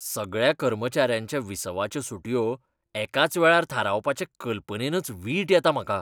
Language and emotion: Goan Konkani, disgusted